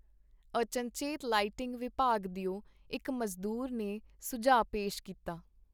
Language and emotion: Punjabi, neutral